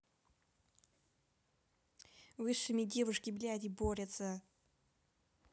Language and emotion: Russian, angry